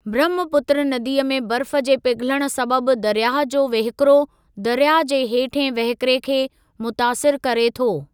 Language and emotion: Sindhi, neutral